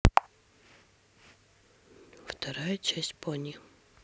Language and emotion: Russian, neutral